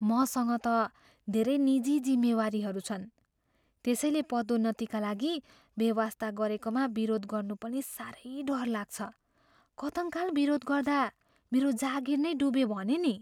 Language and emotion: Nepali, fearful